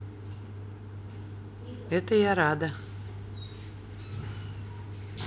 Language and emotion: Russian, neutral